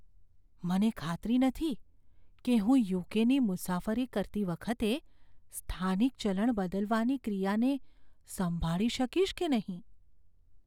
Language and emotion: Gujarati, fearful